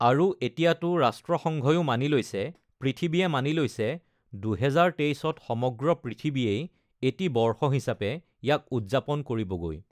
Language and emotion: Assamese, neutral